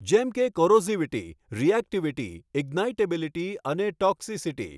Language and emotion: Gujarati, neutral